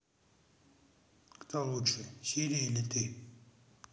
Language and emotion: Russian, neutral